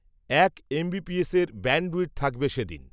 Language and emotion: Bengali, neutral